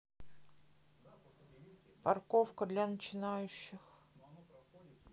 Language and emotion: Russian, sad